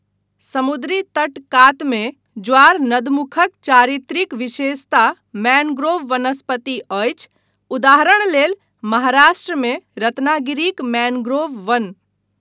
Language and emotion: Maithili, neutral